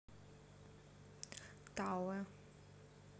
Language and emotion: Russian, neutral